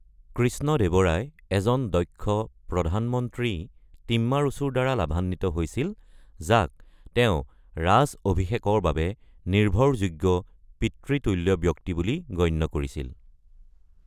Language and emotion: Assamese, neutral